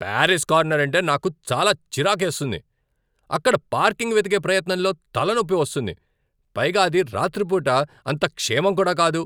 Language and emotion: Telugu, angry